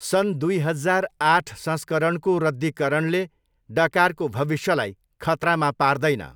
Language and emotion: Nepali, neutral